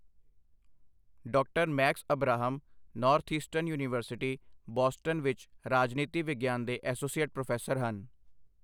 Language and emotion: Punjabi, neutral